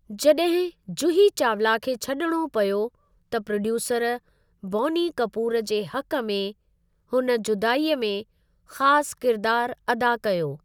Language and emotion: Sindhi, neutral